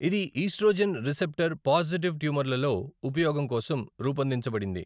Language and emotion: Telugu, neutral